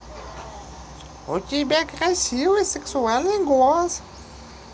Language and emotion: Russian, positive